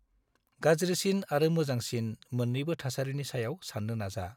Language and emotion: Bodo, neutral